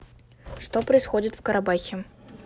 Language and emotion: Russian, neutral